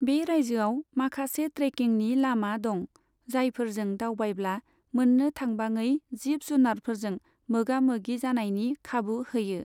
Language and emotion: Bodo, neutral